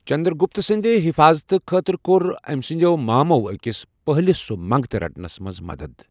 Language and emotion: Kashmiri, neutral